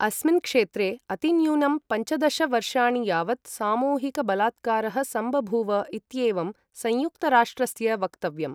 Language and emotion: Sanskrit, neutral